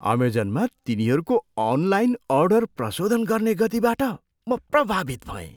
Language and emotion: Nepali, surprised